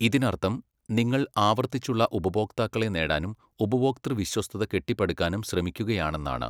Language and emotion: Malayalam, neutral